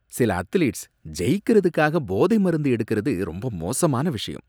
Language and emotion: Tamil, disgusted